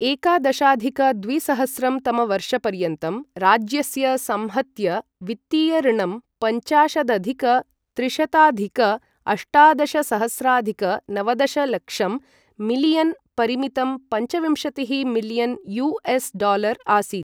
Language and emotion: Sanskrit, neutral